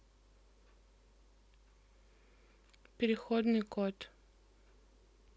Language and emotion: Russian, neutral